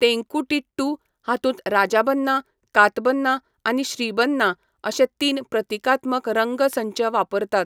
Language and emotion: Goan Konkani, neutral